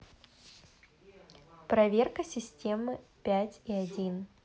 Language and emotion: Russian, positive